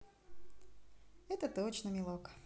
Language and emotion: Russian, positive